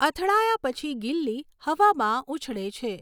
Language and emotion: Gujarati, neutral